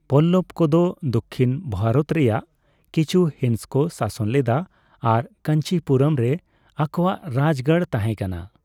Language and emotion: Santali, neutral